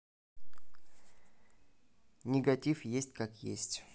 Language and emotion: Russian, neutral